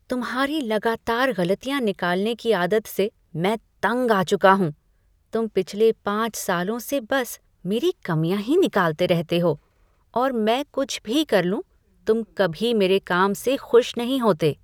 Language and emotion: Hindi, disgusted